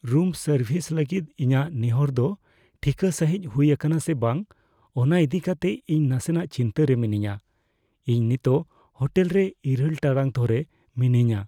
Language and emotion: Santali, fearful